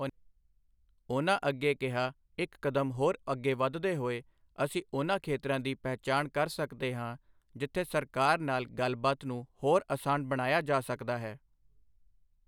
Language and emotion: Punjabi, neutral